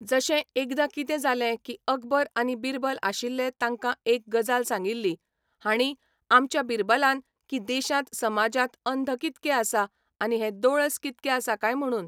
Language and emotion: Goan Konkani, neutral